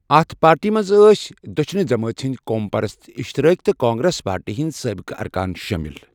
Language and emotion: Kashmiri, neutral